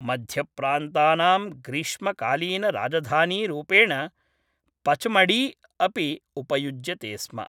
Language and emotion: Sanskrit, neutral